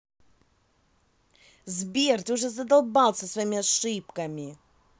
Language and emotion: Russian, angry